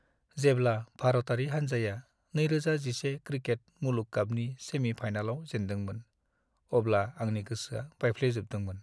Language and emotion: Bodo, sad